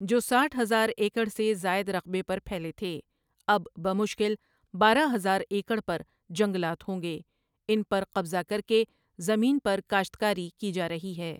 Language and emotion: Urdu, neutral